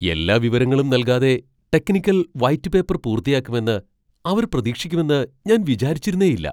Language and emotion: Malayalam, surprised